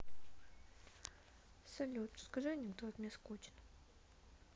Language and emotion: Russian, sad